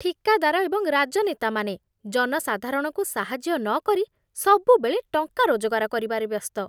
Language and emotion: Odia, disgusted